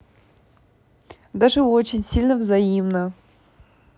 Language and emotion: Russian, positive